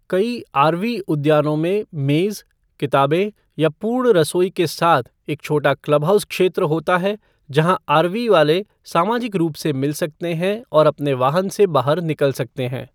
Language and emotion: Hindi, neutral